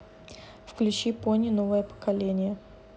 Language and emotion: Russian, neutral